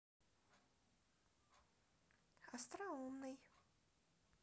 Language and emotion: Russian, positive